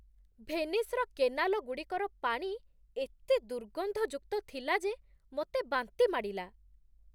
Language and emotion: Odia, disgusted